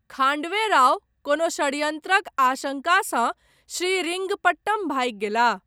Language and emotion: Maithili, neutral